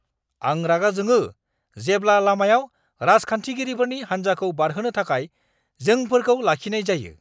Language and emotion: Bodo, angry